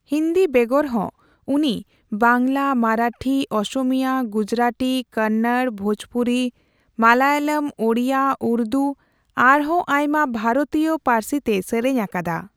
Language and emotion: Santali, neutral